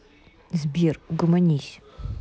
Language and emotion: Russian, angry